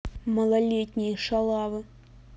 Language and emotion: Russian, angry